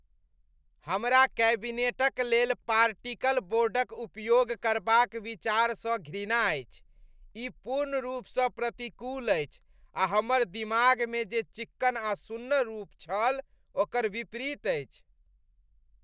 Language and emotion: Maithili, disgusted